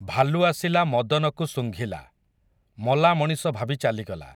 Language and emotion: Odia, neutral